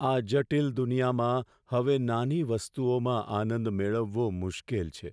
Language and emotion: Gujarati, sad